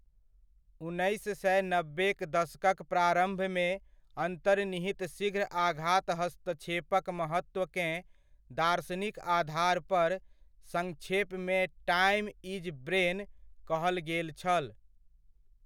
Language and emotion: Maithili, neutral